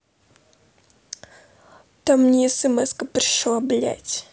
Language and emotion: Russian, angry